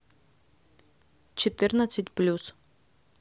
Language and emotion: Russian, neutral